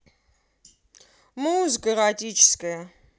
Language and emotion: Russian, positive